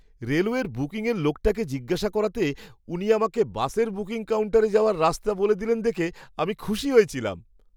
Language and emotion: Bengali, happy